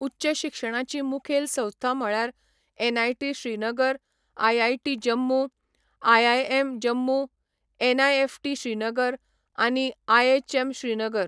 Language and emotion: Goan Konkani, neutral